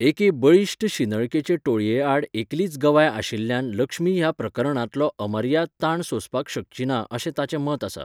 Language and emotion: Goan Konkani, neutral